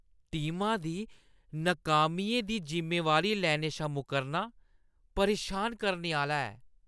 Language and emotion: Dogri, disgusted